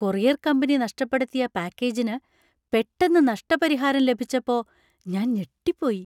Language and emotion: Malayalam, surprised